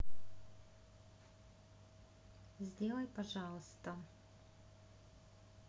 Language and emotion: Russian, neutral